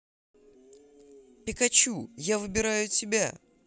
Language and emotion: Russian, positive